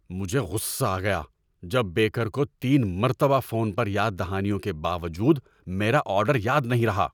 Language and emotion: Urdu, angry